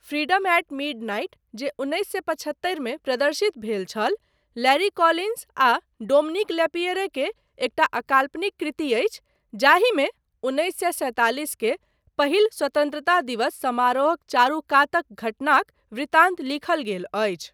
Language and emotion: Maithili, neutral